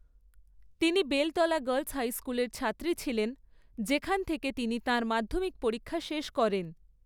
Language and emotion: Bengali, neutral